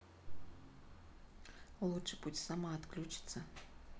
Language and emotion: Russian, neutral